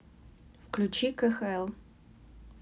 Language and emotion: Russian, neutral